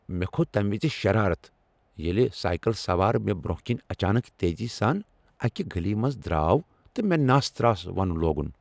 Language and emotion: Kashmiri, angry